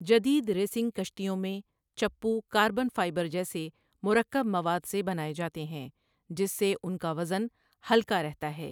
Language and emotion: Urdu, neutral